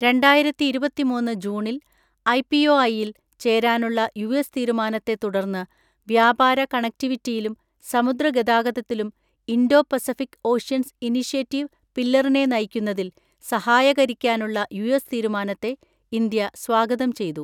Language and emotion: Malayalam, neutral